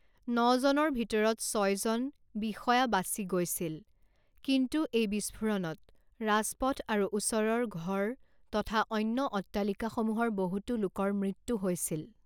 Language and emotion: Assamese, neutral